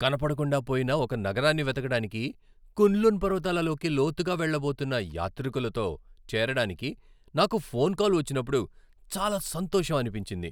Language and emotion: Telugu, happy